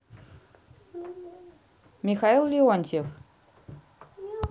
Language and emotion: Russian, neutral